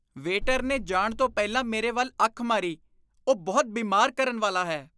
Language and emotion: Punjabi, disgusted